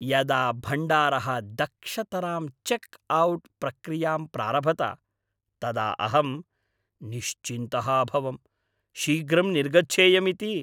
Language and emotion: Sanskrit, happy